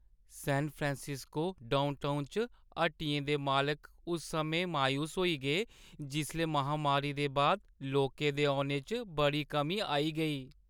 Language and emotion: Dogri, sad